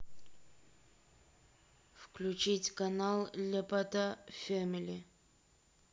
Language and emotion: Russian, neutral